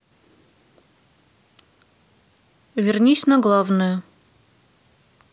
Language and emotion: Russian, neutral